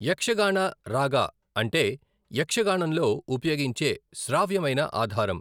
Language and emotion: Telugu, neutral